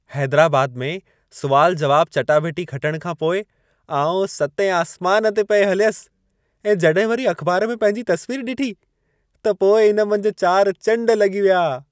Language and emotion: Sindhi, happy